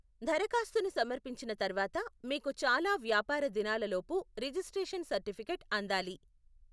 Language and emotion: Telugu, neutral